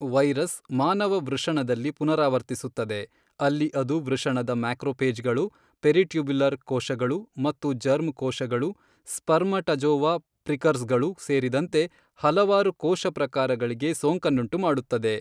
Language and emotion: Kannada, neutral